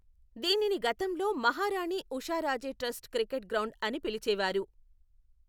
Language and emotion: Telugu, neutral